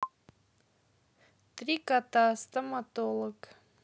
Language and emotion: Russian, neutral